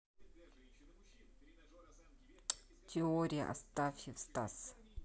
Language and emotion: Russian, neutral